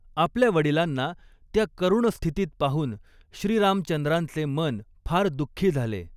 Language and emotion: Marathi, neutral